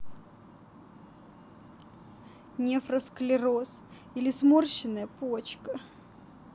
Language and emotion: Russian, sad